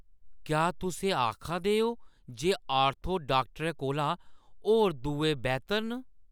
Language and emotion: Dogri, surprised